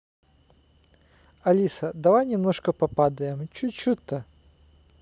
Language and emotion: Russian, neutral